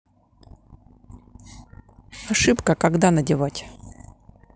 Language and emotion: Russian, neutral